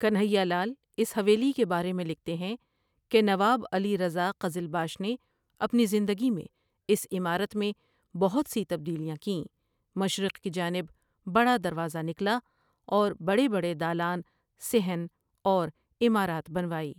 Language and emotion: Urdu, neutral